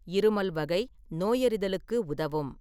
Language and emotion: Tamil, neutral